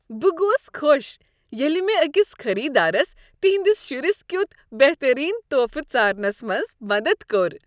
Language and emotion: Kashmiri, happy